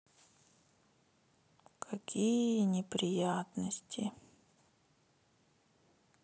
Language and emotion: Russian, sad